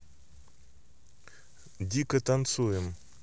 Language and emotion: Russian, neutral